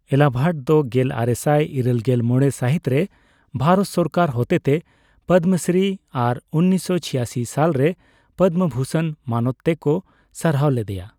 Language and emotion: Santali, neutral